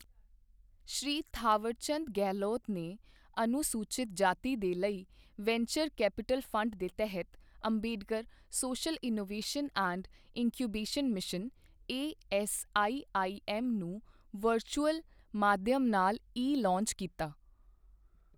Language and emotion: Punjabi, neutral